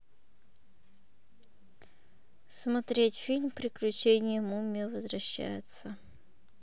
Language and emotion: Russian, neutral